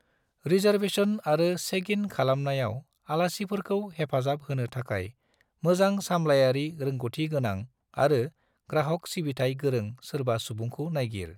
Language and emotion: Bodo, neutral